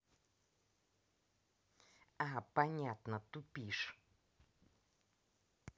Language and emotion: Russian, angry